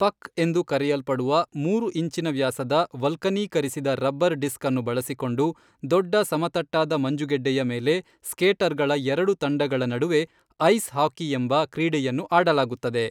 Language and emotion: Kannada, neutral